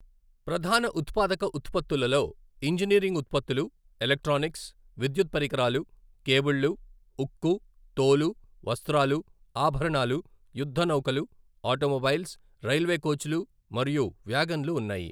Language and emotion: Telugu, neutral